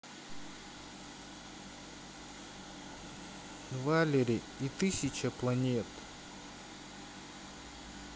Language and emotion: Russian, sad